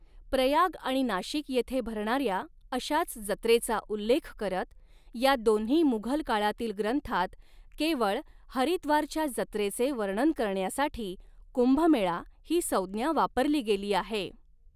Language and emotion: Marathi, neutral